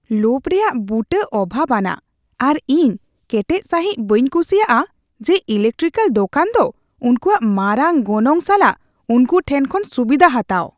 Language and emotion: Santali, disgusted